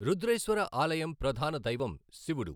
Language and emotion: Telugu, neutral